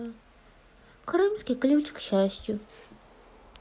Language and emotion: Russian, sad